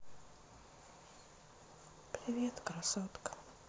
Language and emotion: Russian, sad